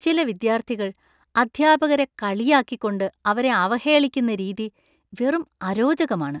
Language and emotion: Malayalam, disgusted